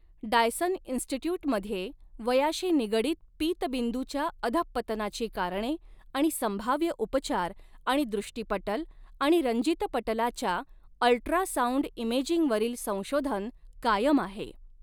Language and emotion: Marathi, neutral